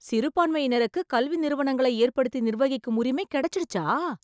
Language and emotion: Tamil, surprised